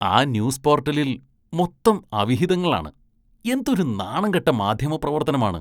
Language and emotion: Malayalam, disgusted